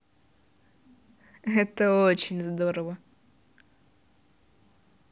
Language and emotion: Russian, positive